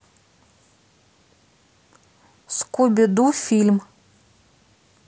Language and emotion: Russian, neutral